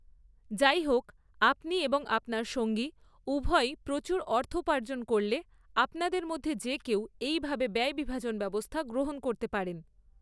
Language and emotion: Bengali, neutral